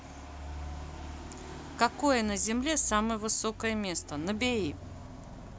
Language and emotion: Russian, neutral